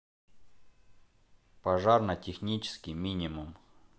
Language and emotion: Russian, neutral